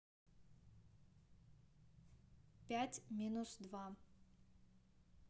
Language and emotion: Russian, neutral